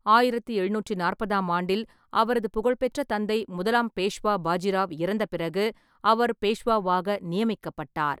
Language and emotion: Tamil, neutral